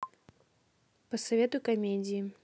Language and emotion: Russian, neutral